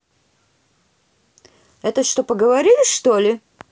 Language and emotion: Russian, angry